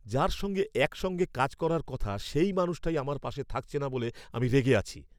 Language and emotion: Bengali, angry